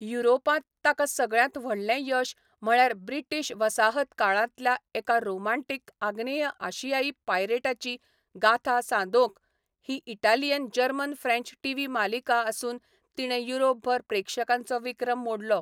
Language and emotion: Goan Konkani, neutral